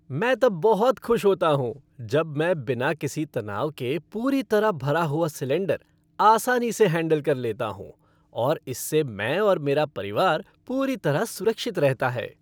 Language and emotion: Hindi, happy